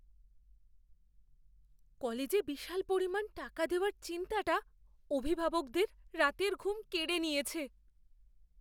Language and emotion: Bengali, fearful